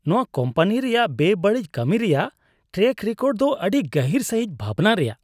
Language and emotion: Santali, disgusted